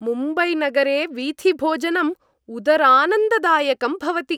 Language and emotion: Sanskrit, happy